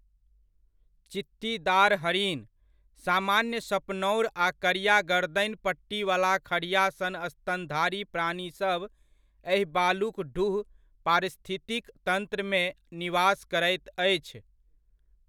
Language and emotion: Maithili, neutral